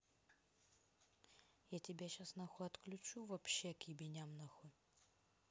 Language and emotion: Russian, angry